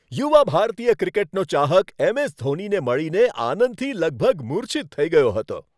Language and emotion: Gujarati, happy